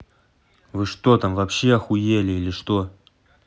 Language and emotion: Russian, angry